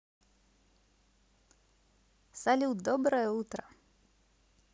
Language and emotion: Russian, positive